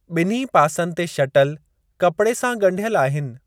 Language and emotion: Sindhi, neutral